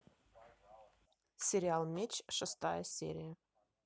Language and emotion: Russian, neutral